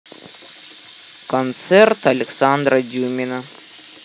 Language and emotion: Russian, neutral